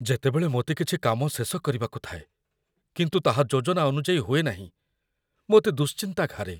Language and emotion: Odia, fearful